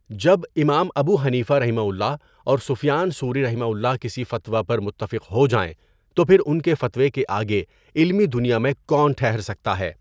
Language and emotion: Urdu, neutral